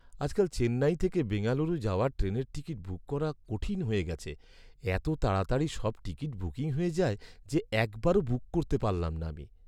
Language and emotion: Bengali, sad